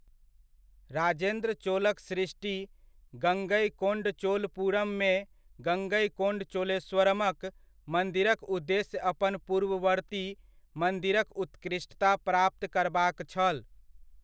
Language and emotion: Maithili, neutral